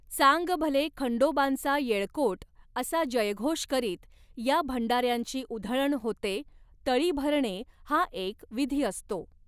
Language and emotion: Marathi, neutral